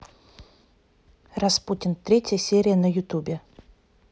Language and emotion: Russian, neutral